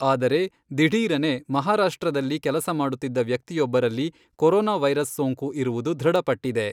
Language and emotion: Kannada, neutral